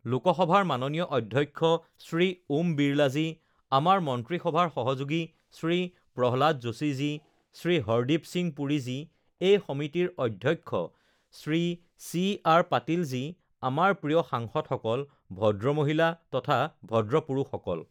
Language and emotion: Assamese, neutral